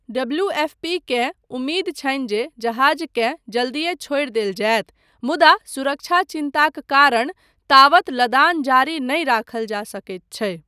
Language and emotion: Maithili, neutral